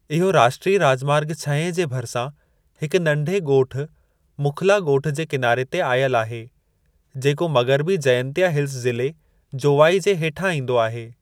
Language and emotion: Sindhi, neutral